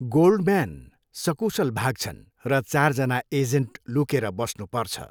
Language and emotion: Nepali, neutral